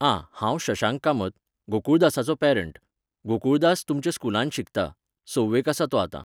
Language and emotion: Goan Konkani, neutral